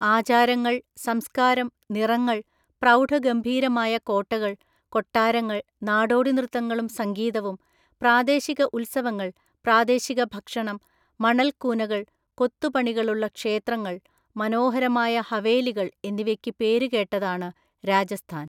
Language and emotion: Malayalam, neutral